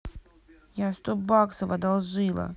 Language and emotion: Russian, angry